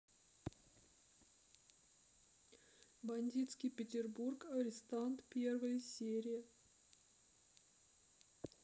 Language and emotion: Russian, sad